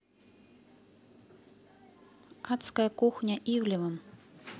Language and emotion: Russian, neutral